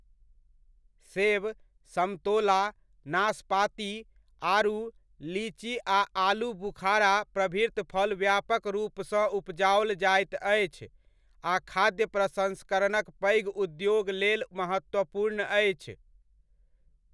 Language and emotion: Maithili, neutral